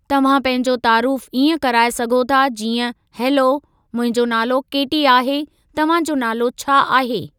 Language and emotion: Sindhi, neutral